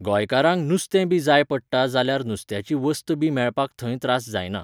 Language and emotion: Goan Konkani, neutral